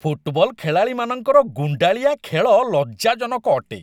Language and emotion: Odia, disgusted